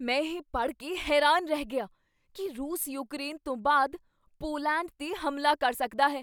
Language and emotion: Punjabi, surprised